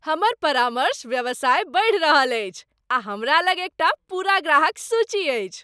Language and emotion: Maithili, happy